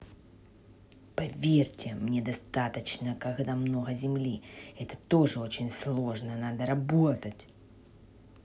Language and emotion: Russian, angry